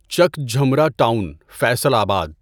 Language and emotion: Urdu, neutral